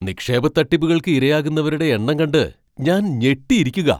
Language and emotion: Malayalam, surprised